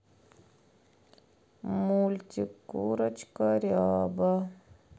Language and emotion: Russian, sad